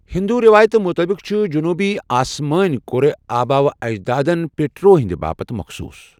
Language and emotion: Kashmiri, neutral